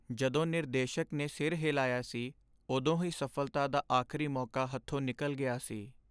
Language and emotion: Punjabi, sad